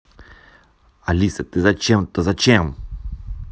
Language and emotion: Russian, angry